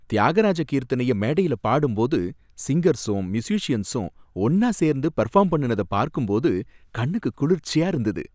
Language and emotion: Tamil, happy